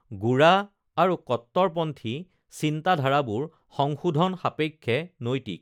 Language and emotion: Assamese, neutral